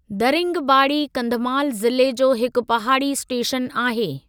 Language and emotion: Sindhi, neutral